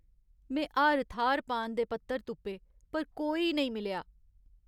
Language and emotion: Dogri, sad